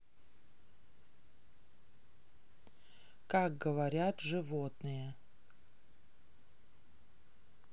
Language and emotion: Russian, neutral